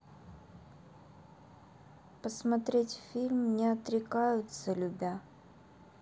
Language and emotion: Russian, neutral